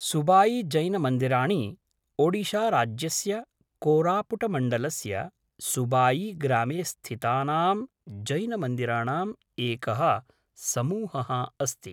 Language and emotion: Sanskrit, neutral